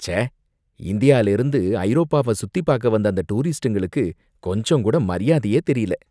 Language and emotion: Tamil, disgusted